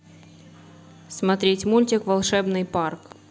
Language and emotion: Russian, neutral